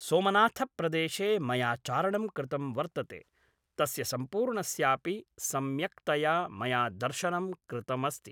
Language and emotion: Sanskrit, neutral